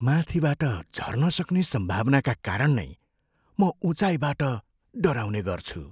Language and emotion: Nepali, fearful